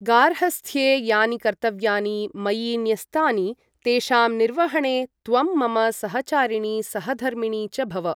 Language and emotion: Sanskrit, neutral